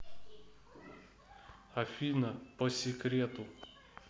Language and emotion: Russian, neutral